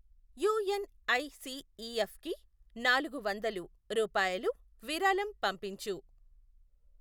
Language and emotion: Telugu, neutral